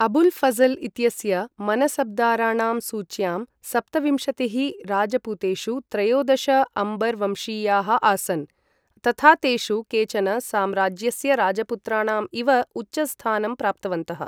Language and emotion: Sanskrit, neutral